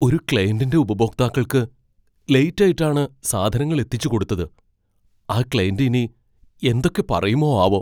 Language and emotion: Malayalam, fearful